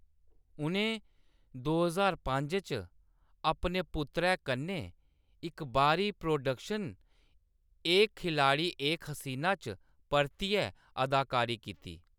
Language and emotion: Dogri, neutral